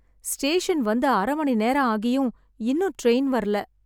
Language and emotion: Tamil, sad